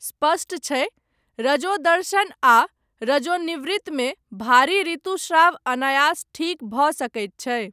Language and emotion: Maithili, neutral